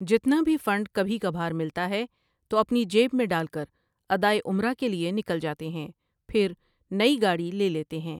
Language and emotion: Urdu, neutral